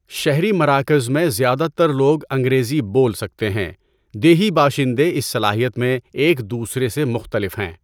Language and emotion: Urdu, neutral